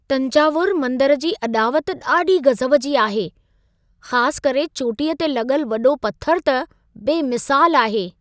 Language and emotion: Sindhi, surprised